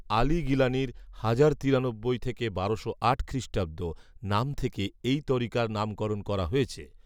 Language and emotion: Bengali, neutral